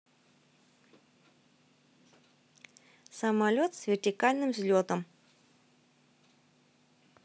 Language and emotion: Russian, neutral